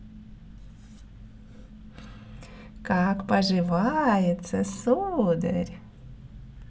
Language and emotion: Russian, positive